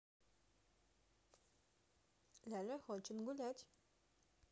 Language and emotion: Russian, positive